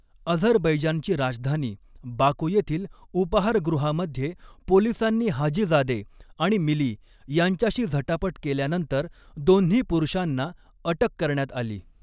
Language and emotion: Marathi, neutral